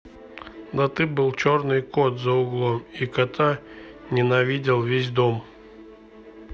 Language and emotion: Russian, neutral